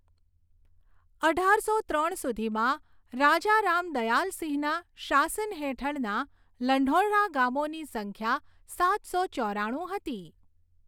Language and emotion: Gujarati, neutral